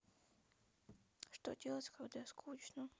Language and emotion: Russian, sad